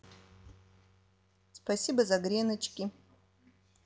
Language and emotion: Russian, positive